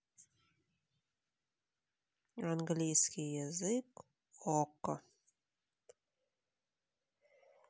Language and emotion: Russian, neutral